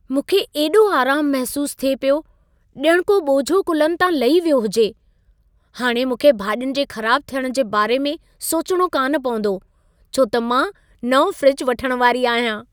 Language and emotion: Sindhi, happy